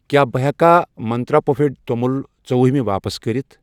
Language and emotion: Kashmiri, neutral